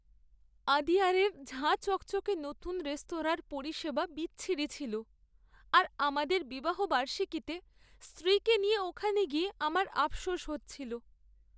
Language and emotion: Bengali, sad